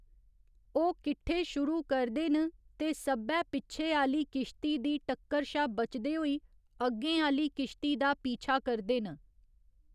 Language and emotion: Dogri, neutral